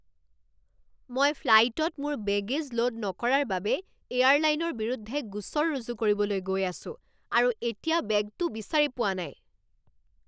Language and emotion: Assamese, angry